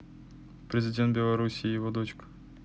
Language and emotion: Russian, neutral